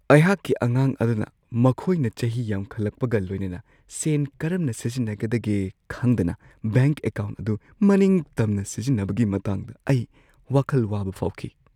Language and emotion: Manipuri, fearful